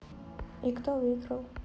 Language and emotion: Russian, neutral